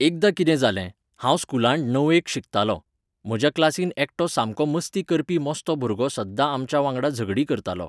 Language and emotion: Goan Konkani, neutral